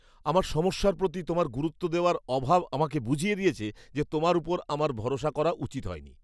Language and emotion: Bengali, disgusted